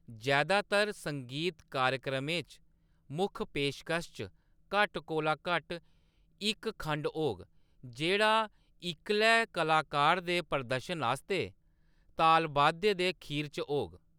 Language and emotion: Dogri, neutral